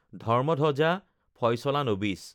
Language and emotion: Assamese, neutral